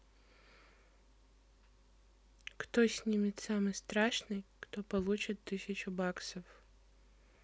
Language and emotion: Russian, neutral